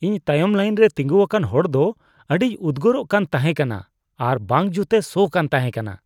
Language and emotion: Santali, disgusted